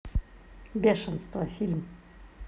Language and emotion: Russian, neutral